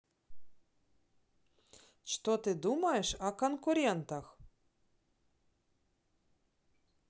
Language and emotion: Russian, positive